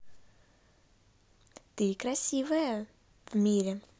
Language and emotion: Russian, positive